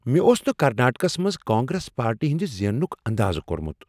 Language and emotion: Kashmiri, surprised